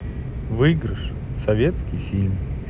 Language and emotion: Russian, neutral